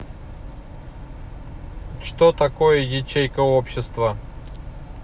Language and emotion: Russian, neutral